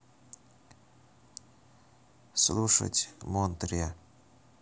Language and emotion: Russian, neutral